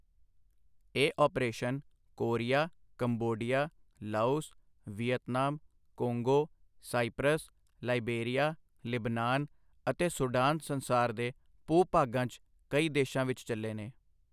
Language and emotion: Punjabi, neutral